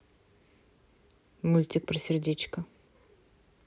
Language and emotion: Russian, neutral